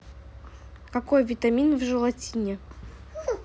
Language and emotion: Russian, neutral